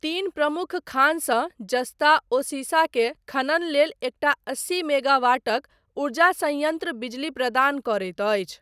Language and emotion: Maithili, neutral